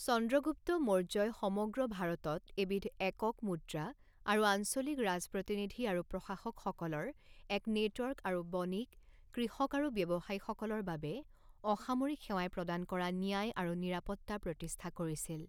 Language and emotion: Assamese, neutral